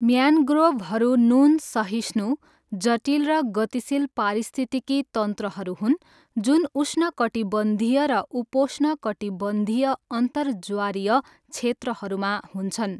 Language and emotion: Nepali, neutral